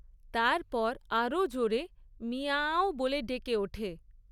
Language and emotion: Bengali, neutral